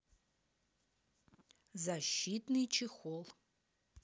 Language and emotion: Russian, neutral